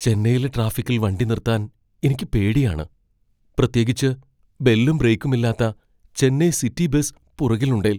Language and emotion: Malayalam, fearful